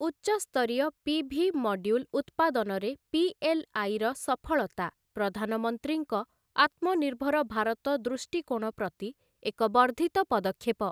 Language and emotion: Odia, neutral